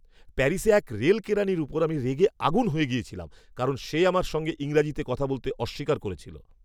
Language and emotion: Bengali, angry